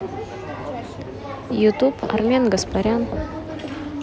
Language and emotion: Russian, neutral